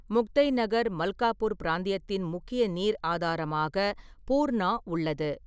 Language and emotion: Tamil, neutral